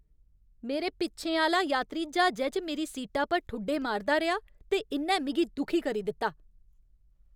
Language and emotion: Dogri, angry